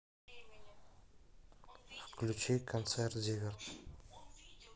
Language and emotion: Russian, neutral